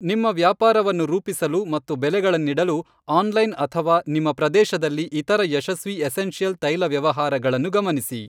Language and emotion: Kannada, neutral